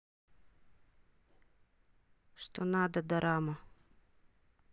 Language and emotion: Russian, neutral